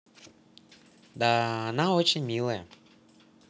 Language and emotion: Russian, positive